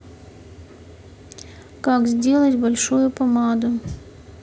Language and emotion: Russian, neutral